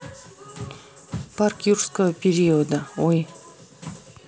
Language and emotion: Russian, neutral